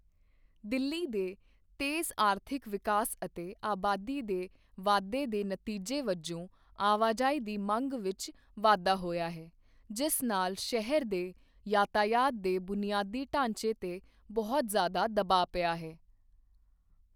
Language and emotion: Punjabi, neutral